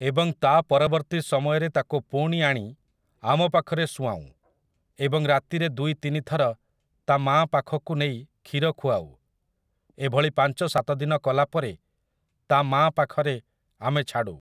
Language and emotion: Odia, neutral